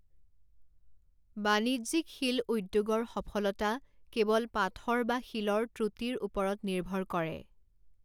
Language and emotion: Assamese, neutral